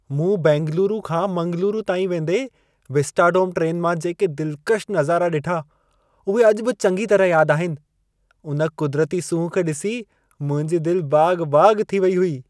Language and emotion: Sindhi, happy